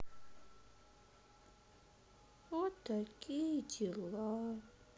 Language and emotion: Russian, sad